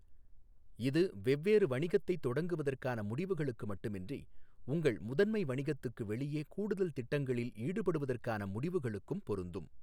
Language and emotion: Tamil, neutral